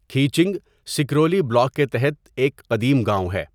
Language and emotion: Urdu, neutral